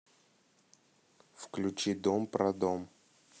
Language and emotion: Russian, neutral